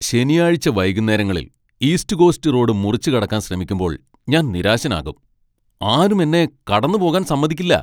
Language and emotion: Malayalam, angry